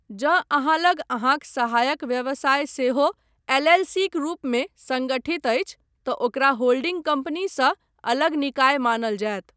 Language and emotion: Maithili, neutral